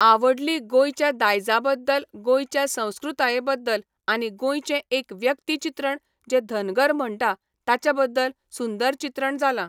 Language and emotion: Goan Konkani, neutral